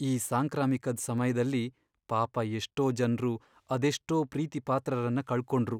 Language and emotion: Kannada, sad